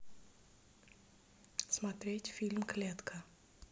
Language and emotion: Russian, neutral